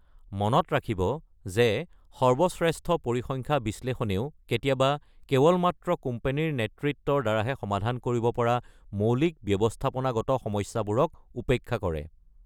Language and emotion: Assamese, neutral